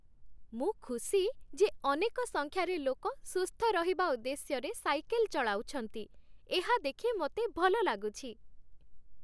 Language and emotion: Odia, happy